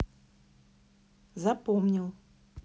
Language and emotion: Russian, neutral